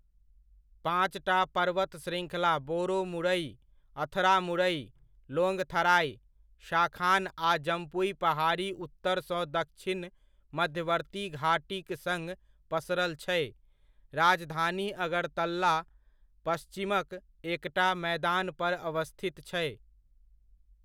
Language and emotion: Maithili, neutral